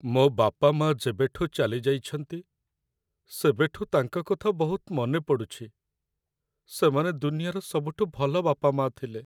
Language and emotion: Odia, sad